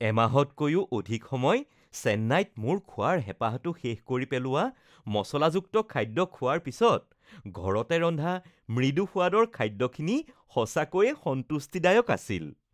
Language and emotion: Assamese, happy